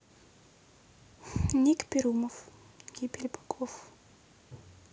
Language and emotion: Russian, neutral